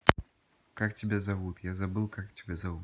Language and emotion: Russian, neutral